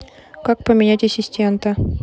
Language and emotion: Russian, neutral